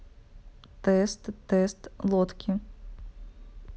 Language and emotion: Russian, neutral